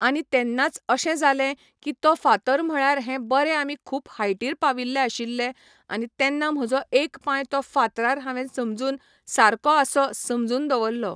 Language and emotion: Goan Konkani, neutral